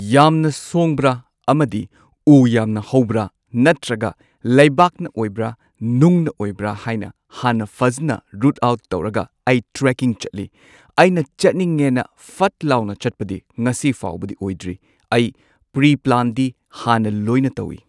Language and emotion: Manipuri, neutral